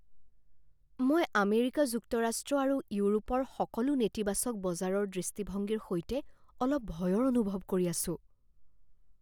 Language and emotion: Assamese, fearful